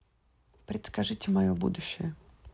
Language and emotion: Russian, neutral